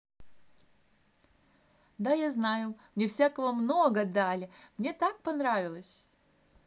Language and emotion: Russian, positive